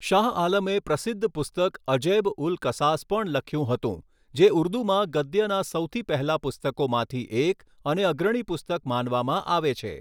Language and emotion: Gujarati, neutral